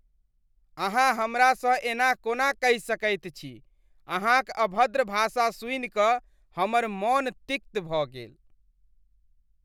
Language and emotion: Maithili, disgusted